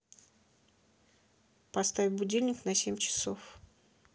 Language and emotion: Russian, neutral